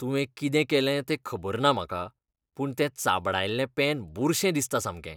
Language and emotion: Goan Konkani, disgusted